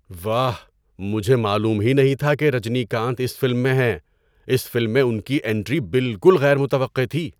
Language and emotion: Urdu, surprised